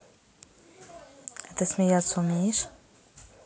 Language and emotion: Russian, neutral